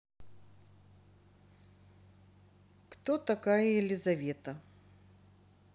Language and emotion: Russian, neutral